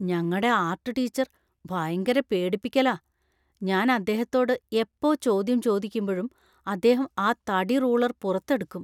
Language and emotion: Malayalam, fearful